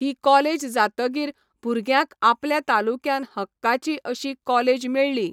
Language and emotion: Goan Konkani, neutral